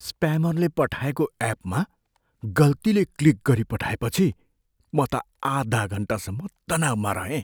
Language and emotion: Nepali, fearful